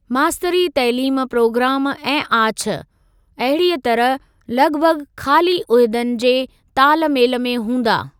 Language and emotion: Sindhi, neutral